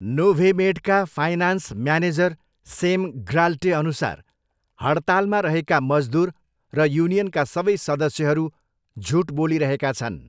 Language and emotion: Nepali, neutral